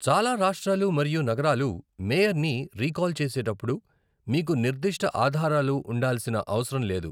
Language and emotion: Telugu, neutral